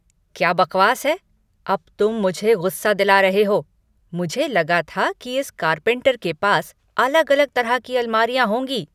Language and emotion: Hindi, angry